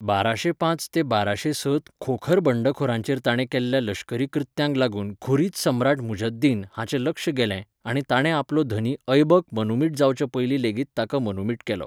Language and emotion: Goan Konkani, neutral